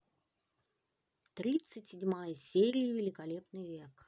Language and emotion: Russian, neutral